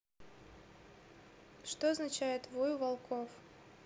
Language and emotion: Russian, neutral